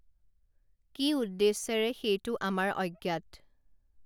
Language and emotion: Assamese, neutral